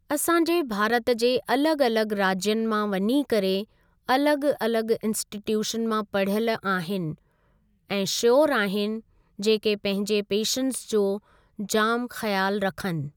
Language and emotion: Sindhi, neutral